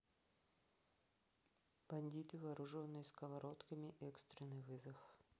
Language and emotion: Russian, neutral